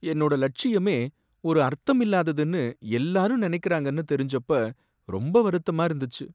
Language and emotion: Tamil, sad